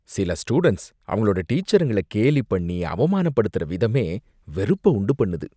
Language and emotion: Tamil, disgusted